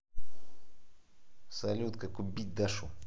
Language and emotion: Russian, angry